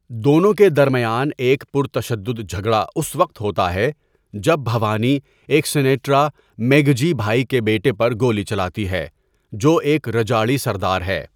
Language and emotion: Urdu, neutral